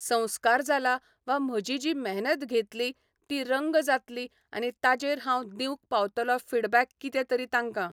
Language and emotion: Goan Konkani, neutral